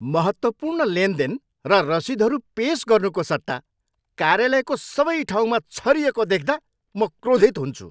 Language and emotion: Nepali, angry